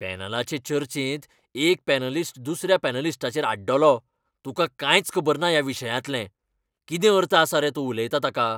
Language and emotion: Goan Konkani, angry